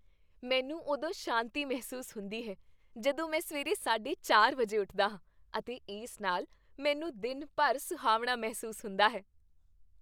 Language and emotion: Punjabi, happy